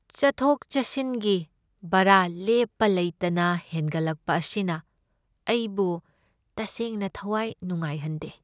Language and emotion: Manipuri, sad